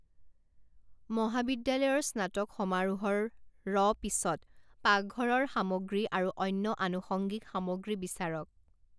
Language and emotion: Assamese, neutral